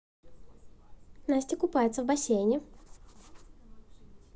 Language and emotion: Russian, positive